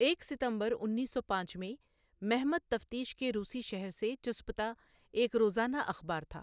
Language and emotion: Urdu, neutral